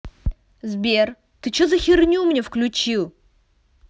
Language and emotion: Russian, angry